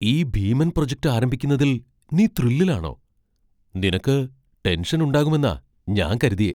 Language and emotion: Malayalam, surprised